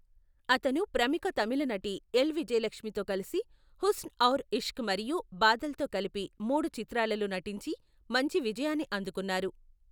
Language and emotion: Telugu, neutral